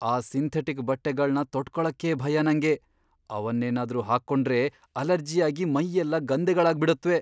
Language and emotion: Kannada, fearful